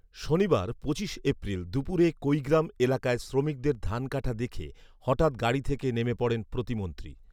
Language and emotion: Bengali, neutral